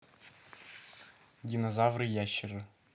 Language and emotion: Russian, neutral